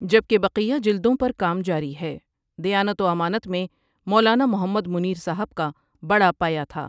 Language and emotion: Urdu, neutral